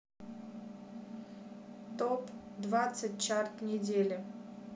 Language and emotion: Russian, neutral